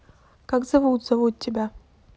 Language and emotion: Russian, neutral